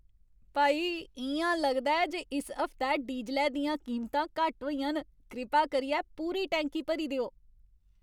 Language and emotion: Dogri, happy